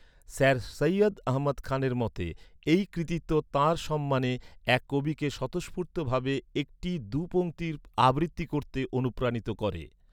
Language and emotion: Bengali, neutral